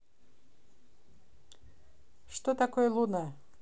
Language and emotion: Russian, neutral